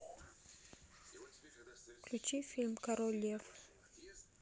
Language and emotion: Russian, neutral